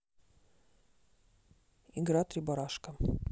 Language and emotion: Russian, neutral